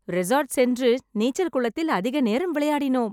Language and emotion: Tamil, happy